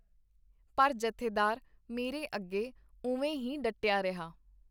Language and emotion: Punjabi, neutral